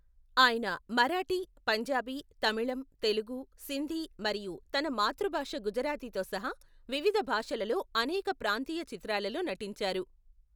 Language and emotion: Telugu, neutral